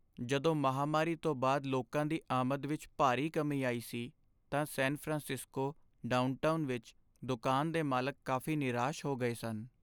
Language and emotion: Punjabi, sad